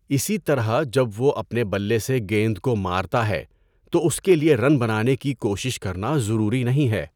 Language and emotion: Urdu, neutral